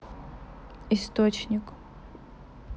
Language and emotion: Russian, neutral